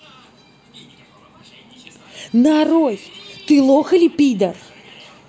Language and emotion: Russian, angry